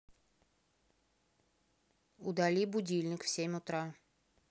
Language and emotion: Russian, neutral